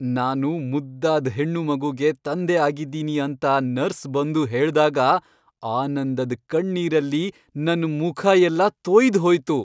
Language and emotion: Kannada, happy